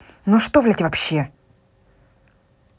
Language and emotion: Russian, angry